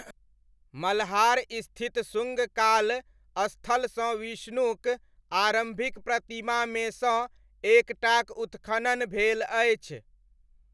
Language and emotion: Maithili, neutral